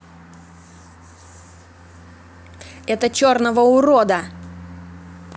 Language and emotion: Russian, angry